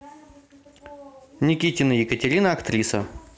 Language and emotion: Russian, neutral